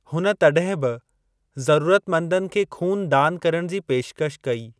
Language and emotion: Sindhi, neutral